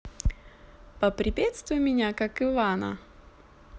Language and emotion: Russian, positive